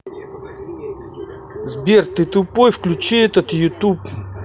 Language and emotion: Russian, angry